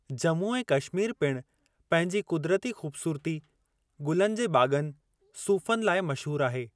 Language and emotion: Sindhi, neutral